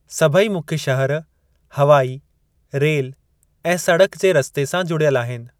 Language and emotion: Sindhi, neutral